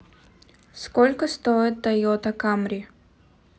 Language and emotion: Russian, neutral